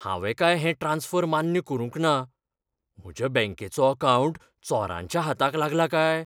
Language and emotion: Goan Konkani, fearful